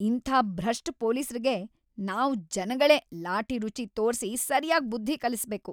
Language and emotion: Kannada, angry